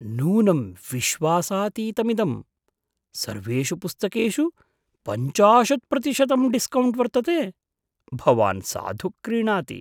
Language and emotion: Sanskrit, surprised